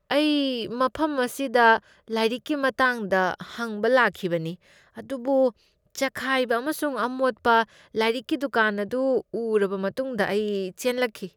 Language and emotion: Manipuri, disgusted